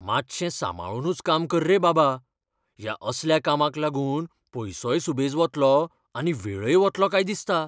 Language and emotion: Goan Konkani, fearful